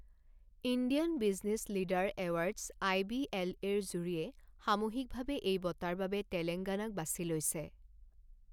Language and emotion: Assamese, neutral